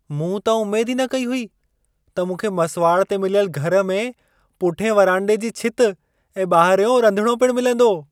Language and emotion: Sindhi, surprised